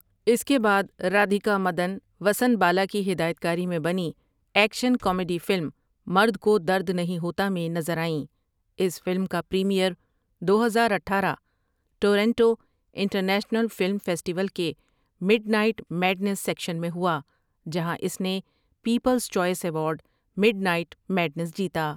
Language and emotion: Urdu, neutral